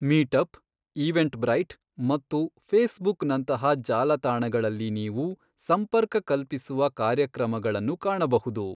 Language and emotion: Kannada, neutral